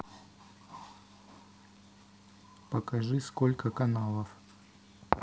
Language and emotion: Russian, neutral